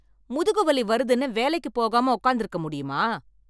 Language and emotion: Tamil, angry